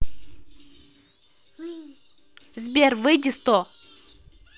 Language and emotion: Russian, neutral